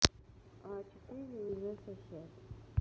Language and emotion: Russian, neutral